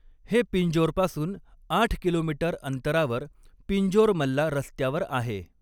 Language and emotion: Marathi, neutral